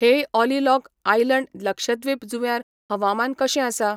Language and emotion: Goan Konkani, neutral